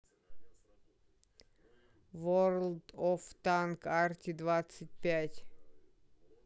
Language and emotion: Russian, neutral